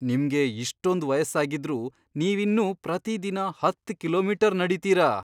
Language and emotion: Kannada, surprised